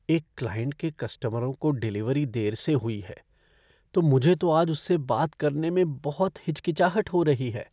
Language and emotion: Hindi, fearful